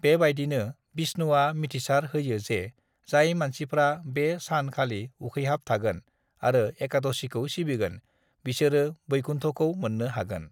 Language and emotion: Bodo, neutral